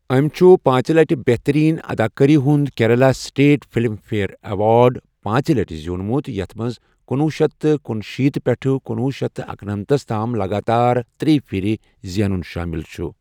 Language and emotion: Kashmiri, neutral